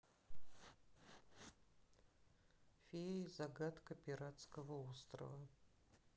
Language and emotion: Russian, neutral